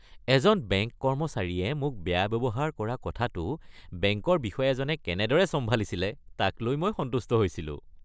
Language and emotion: Assamese, happy